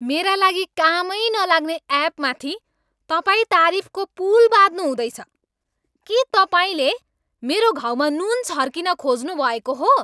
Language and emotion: Nepali, angry